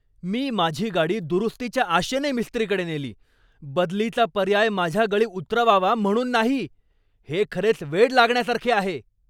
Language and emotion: Marathi, angry